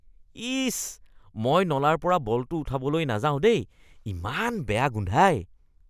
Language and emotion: Assamese, disgusted